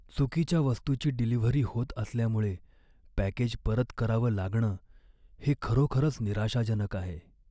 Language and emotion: Marathi, sad